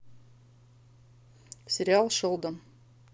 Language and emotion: Russian, neutral